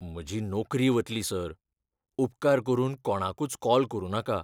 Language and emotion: Goan Konkani, fearful